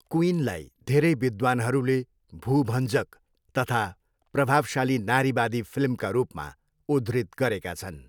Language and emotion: Nepali, neutral